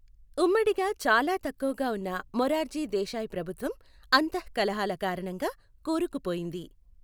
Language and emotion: Telugu, neutral